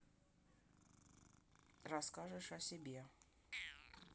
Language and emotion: Russian, neutral